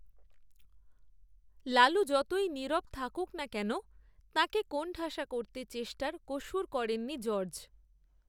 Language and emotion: Bengali, neutral